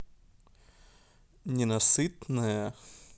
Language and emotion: Russian, positive